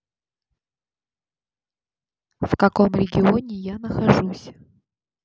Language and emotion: Russian, neutral